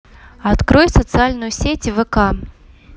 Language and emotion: Russian, neutral